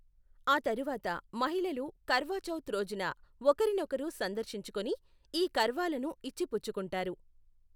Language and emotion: Telugu, neutral